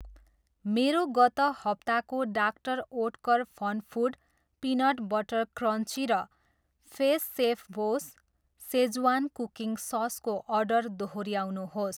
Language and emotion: Nepali, neutral